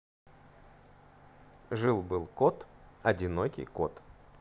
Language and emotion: Russian, neutral